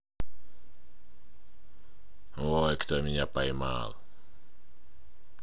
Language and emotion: Russian, positive